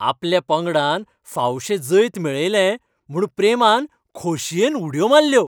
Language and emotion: Goan Konkani, happy